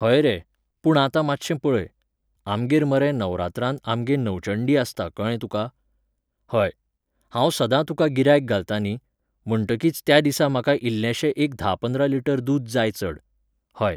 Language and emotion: Goan Konkani, neutral